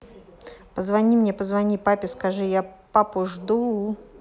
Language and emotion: Russian, neutral